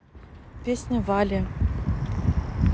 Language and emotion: Russian, neutral